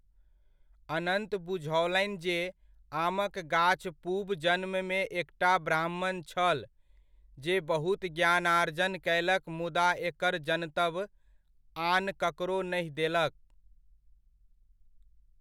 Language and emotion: Maithili, neutral